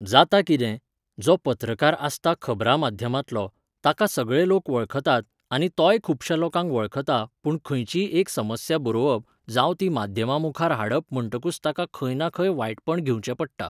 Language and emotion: Goan Konkani, neutral